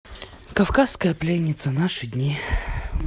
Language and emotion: Russian, sad